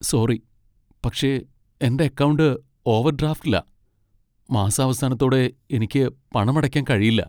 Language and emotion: Malayalam, sad